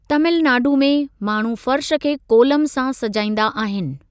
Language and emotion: Sindhi, neutral